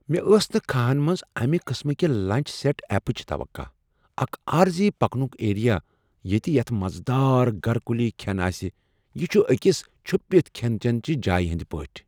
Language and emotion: Kashmiri, surprised